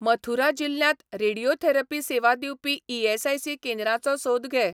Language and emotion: Goan Konkani, neutral